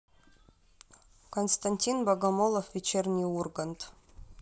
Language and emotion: Russian, neutral